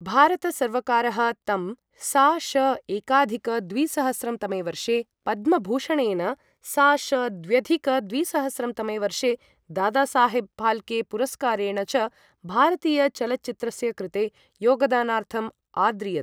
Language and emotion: Sanskrit, neutral